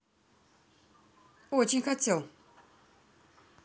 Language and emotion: Russian, neutral